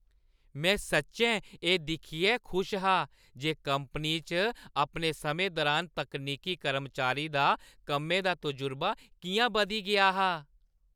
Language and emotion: Dogri, happy